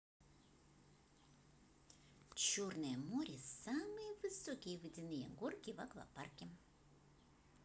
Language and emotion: Russian, positive